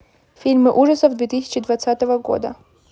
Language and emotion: Russian, neutral